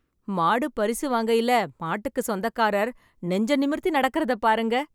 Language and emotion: Tamil, happy